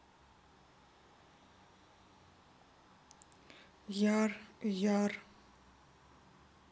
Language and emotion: Russian, neutral